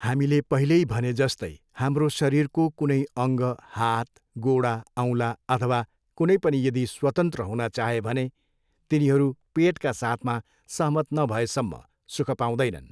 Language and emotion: Nepali, neutral